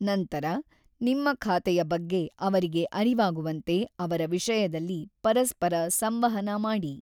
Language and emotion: Kannada, neutral